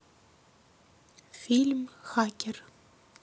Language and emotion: Russian, neutral